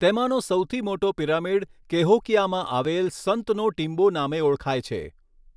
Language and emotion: Gujarati, neutral